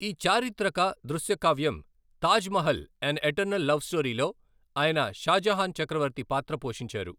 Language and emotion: Telugu, neutral